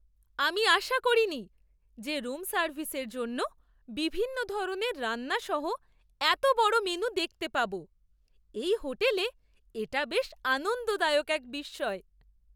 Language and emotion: Bengali, surprised